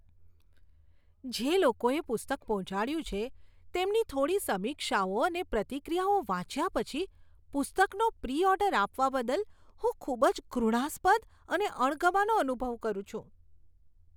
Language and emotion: Gujarati, disgusted